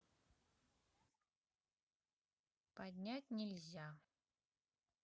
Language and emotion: Russian, neutral